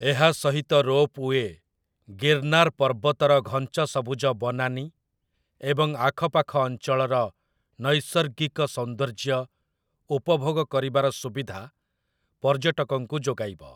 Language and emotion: Odia, neutral